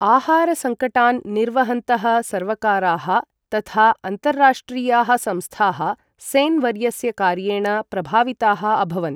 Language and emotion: Sanskrit, neutral